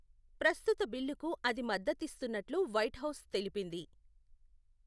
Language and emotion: Telugu, neutral